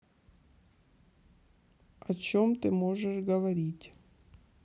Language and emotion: Russian, neutral